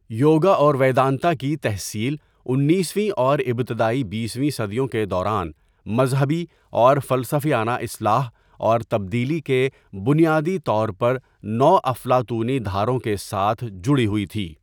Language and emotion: Urdu, neutral